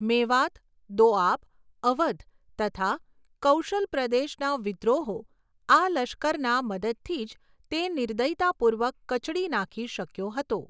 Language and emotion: Gujarati, neutral